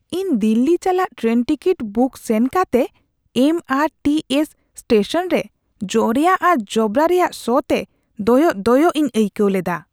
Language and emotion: Santali, disgusted